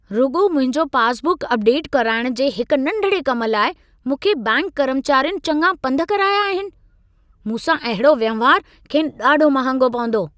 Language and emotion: Sindhi, angry